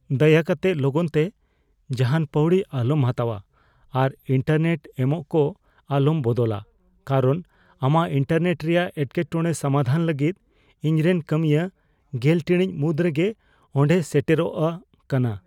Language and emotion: Santali, fearful